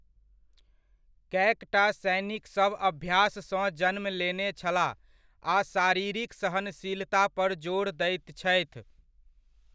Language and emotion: Maithili, neutral